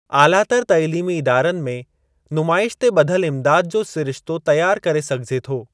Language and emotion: Sindhi, neutral